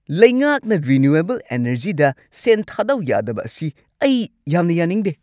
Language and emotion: Manipuri, angry